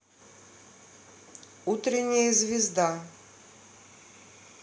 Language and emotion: Russian, neutral